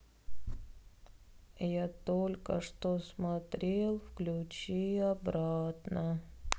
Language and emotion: Russian, sad